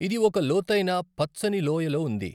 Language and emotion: Telugu, neutral